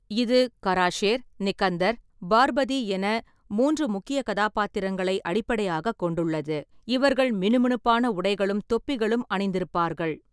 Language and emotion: Tamil, neutral